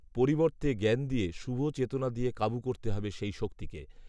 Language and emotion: Bengali, neutral